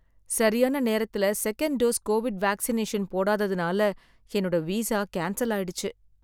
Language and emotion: Tamil, sad